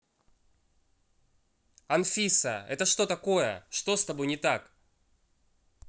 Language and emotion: Russian, angry